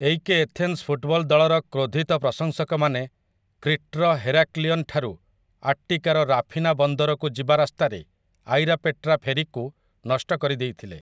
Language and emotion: Odia, neutral